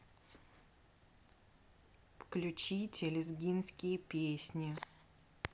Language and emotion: Russian, neutral